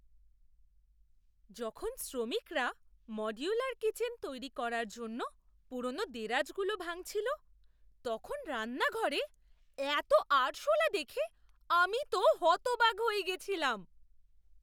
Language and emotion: Bengali, surprised